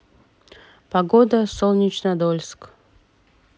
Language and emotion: Russian, neutral